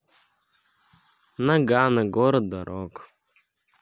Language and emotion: Russian, neutral